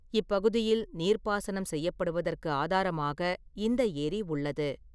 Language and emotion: Tamil, neutral